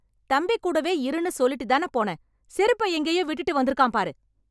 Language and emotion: Tamil, angry